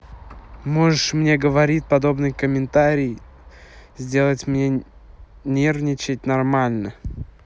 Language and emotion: Russian, neutral